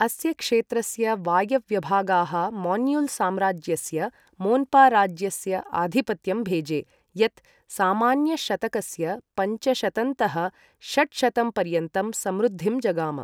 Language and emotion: Sanskrit, neutral